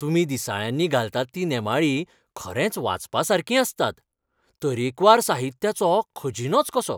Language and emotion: Goan Konkani, happy